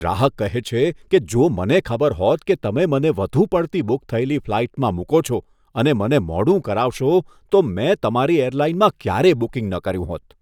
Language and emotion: Gujarati, disgusted